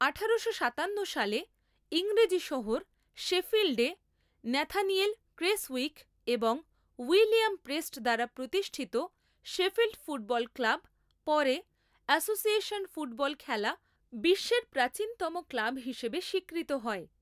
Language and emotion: Bengali, neutral